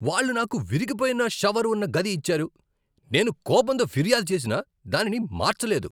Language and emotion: Telugu, angry